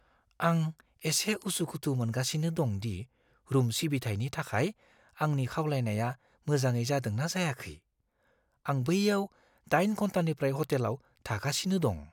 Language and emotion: Bodo, fearful